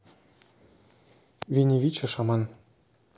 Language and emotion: Russian, neutral